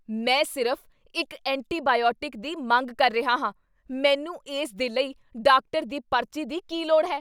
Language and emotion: Punjabi, angry